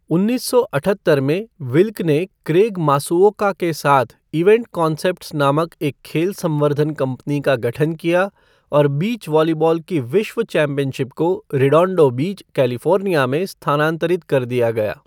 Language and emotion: Hindi, neutral